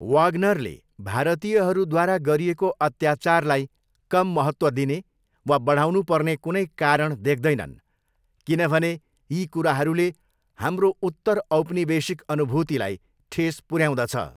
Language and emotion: Nepali, neutral